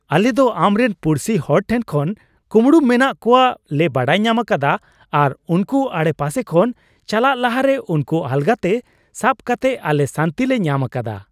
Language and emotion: Santali, happy